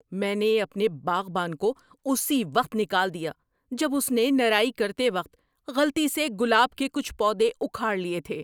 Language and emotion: Urdu, angry